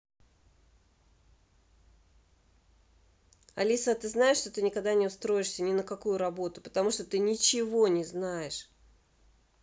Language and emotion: Russian, angry